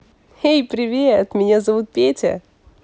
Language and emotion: Russian, positive